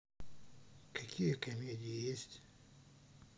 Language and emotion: Russian, neutral